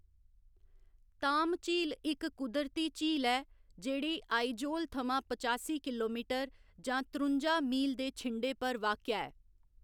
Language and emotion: Dogri, neutral